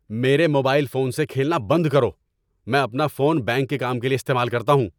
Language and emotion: Urdu, angry